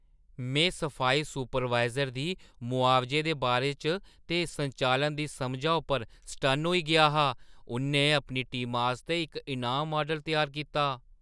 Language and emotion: Dogri, surprised